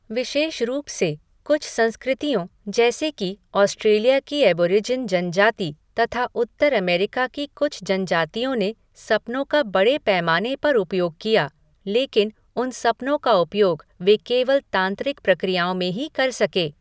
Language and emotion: Hindi, neutral